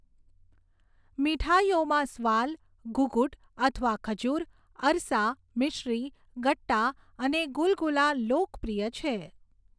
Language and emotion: Gujarati, neutral